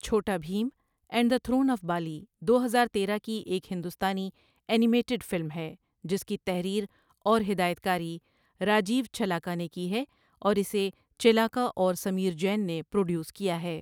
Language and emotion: Urdu, neutral